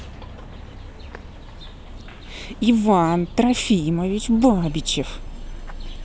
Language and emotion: Russian, angry